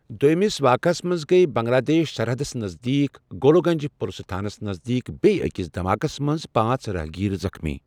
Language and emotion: Kashmiri, neutral